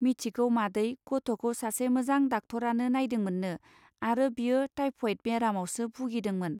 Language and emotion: Bodo, neutral